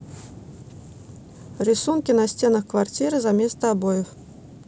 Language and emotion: Russian, neutral